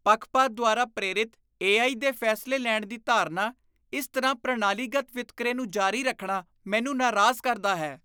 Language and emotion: Punjabi, disgusted